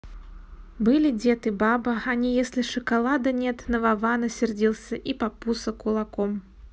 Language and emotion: Russian, neutral